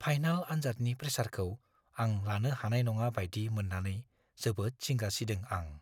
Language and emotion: Bodo, fearful